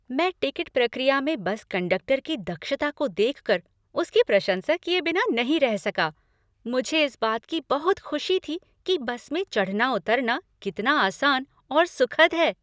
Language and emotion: Hindi, happy